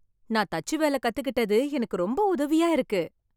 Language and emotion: Tamil, happy